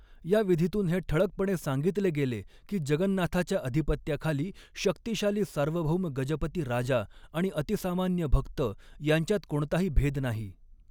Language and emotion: Marathi, neutral